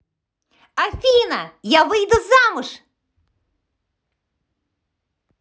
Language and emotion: Russian, positive